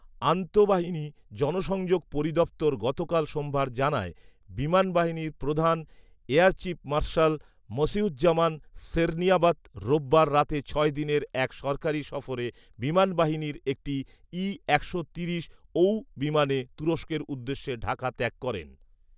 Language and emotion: Bengali, neutral